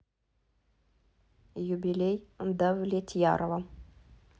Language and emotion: Russian, neutral